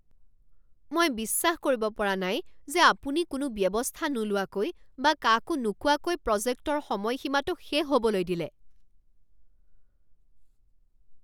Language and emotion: Assamese, angry